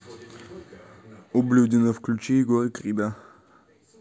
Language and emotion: Russian, angry